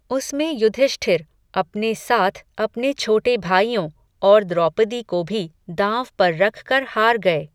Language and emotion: Hindi, neutral